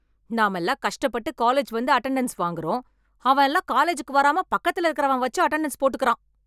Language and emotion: Tamil, angry